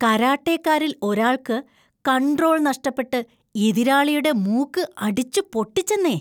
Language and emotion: Malayalam, disgusted